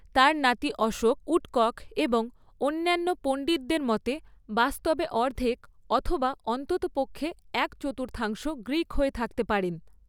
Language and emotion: Bengali, neutral